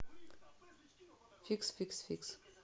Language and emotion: Russian, neutral